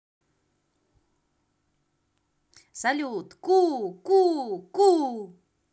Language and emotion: Russian, positive